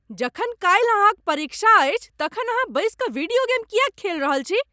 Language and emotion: Maithili, angry